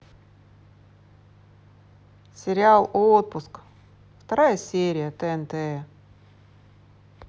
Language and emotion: Russian, neutral